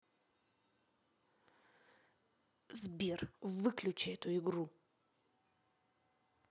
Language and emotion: Russian, angry